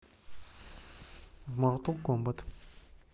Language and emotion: Russian, neutral